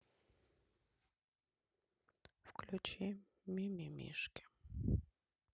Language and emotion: Russian, sad